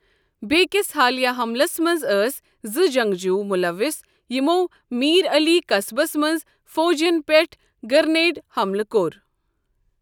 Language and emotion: Kashmiri, neutral